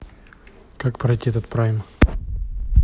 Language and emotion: Russian, neutral